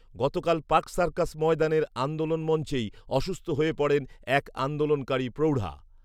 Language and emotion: Bengali, neutral